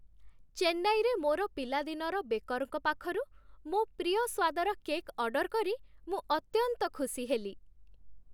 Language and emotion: Odia, happy